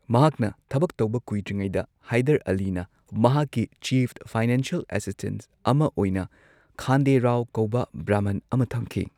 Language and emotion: Manipuri, neutral